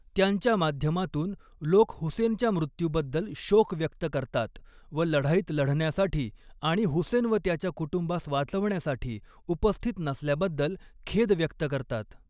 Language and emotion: Marathi, neutral